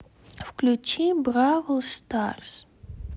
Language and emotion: Russian, neutral